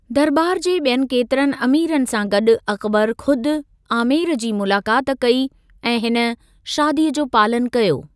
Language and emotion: Sindhi, neutral